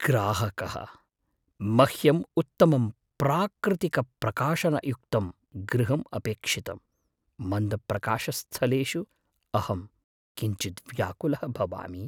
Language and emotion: Sanskrit, fearful